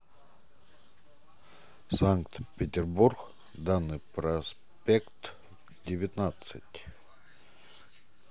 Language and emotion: Russian, neutral